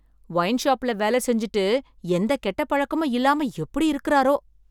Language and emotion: Tamil, surprised